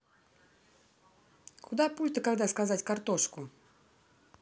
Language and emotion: Russian, neutral